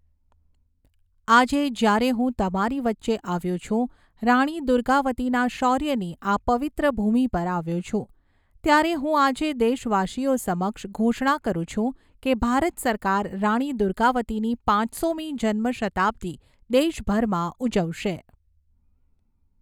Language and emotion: Gujarati, neutral